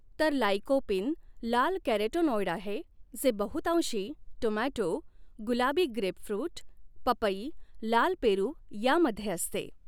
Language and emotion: Marathi, neutral